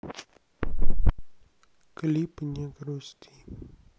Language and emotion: Russian, sad